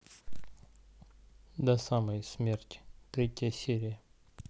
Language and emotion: Russian, neutral